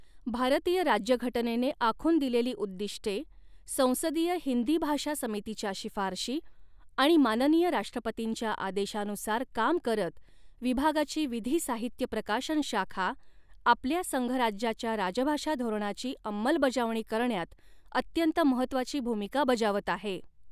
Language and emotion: Marathi, neutral